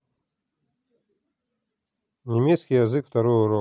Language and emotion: Russian, neutral